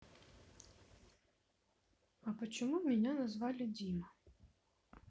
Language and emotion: Russian, sad